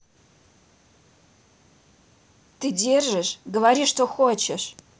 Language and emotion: Russian, angry